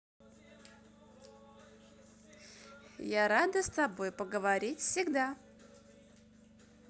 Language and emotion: Russian, positive